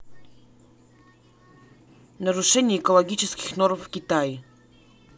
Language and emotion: Russian, neutral